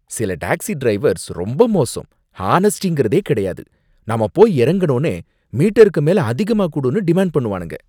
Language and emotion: Tamil, disgusted